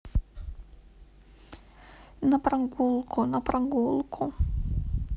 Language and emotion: Russian, sad